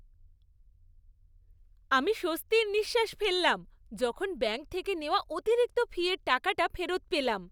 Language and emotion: Bengali, happy